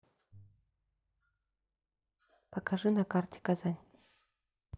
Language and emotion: Russian, neutral